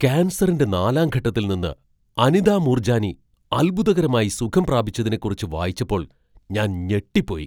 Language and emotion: Malayalam, surprised